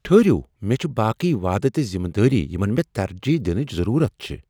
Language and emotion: Kashmiri, surprised